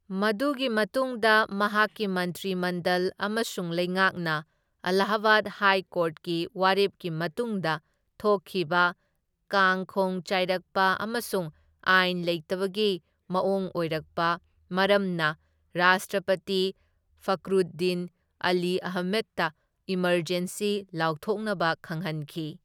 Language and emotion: Manipuri, neutral